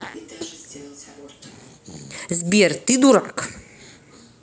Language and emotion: Russian, angry